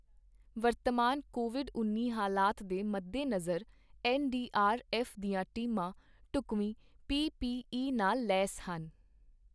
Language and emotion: Punjabi, neutral